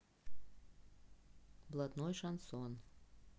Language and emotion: Russian, neutral